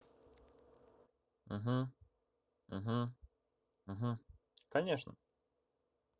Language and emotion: Russian, neutral